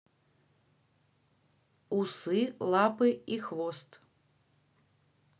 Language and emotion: Russian, neutral